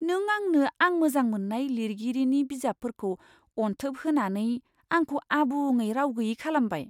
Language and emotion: Bodo, surprised